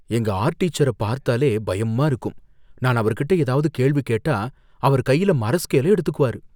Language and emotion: Tamil, fearful